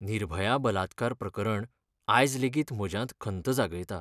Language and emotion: Goan Konkani, sad